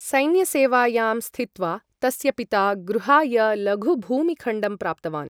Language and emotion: Sanskrit, neutral